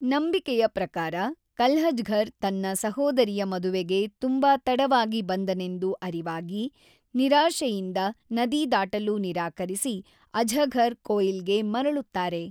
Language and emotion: Kannada, neutral